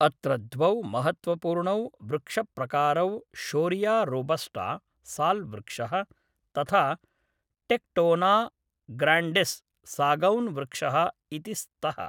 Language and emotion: Sanskrit, neutral